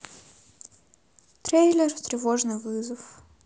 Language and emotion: Russian, sad